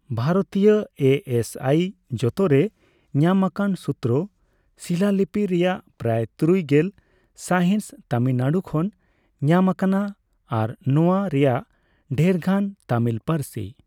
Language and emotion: Santali, neutral